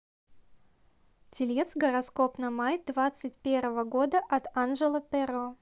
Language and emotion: Russian, neutral